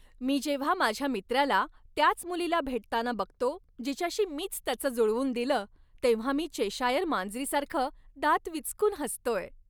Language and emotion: Marathi, happy